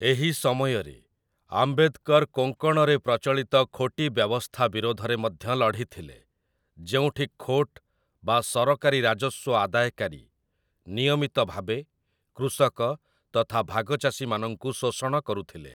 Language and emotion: Odia, neutral